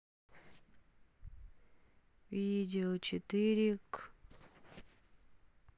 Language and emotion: Russian, sad